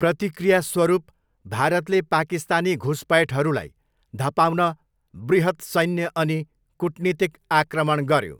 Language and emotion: Nepali, neutral